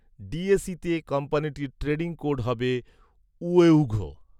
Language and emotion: Bengali, neutral